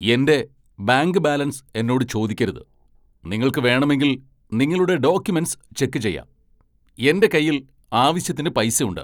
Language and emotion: Malayalam, angry